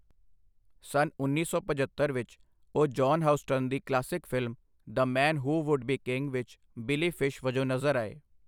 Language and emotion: Punjabi, neutral